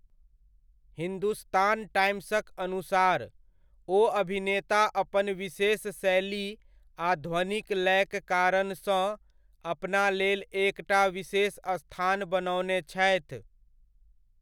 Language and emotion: Maithili, neutral